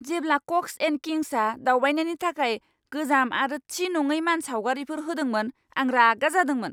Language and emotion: Bodo, angry